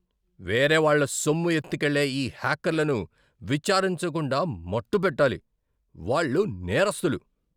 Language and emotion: Telugu, angry